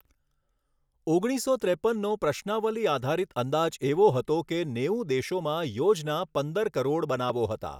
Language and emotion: Gujarati, neutral